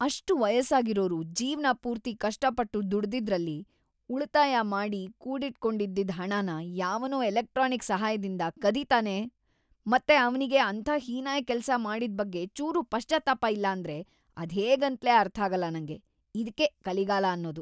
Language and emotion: Kannada, disgusted